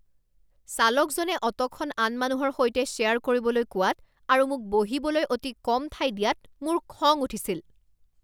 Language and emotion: Assamese, angry